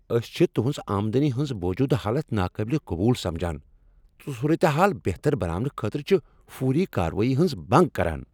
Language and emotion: Kashmiri, angry